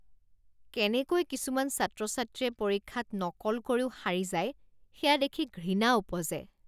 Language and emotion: Assamese, disgusted